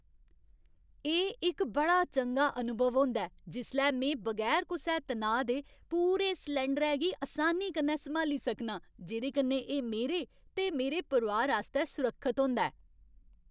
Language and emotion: Dogri, happy